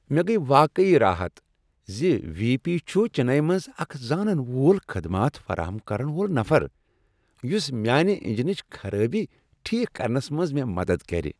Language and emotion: Kashmiri, happy